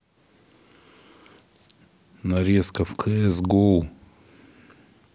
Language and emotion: Russian, neutral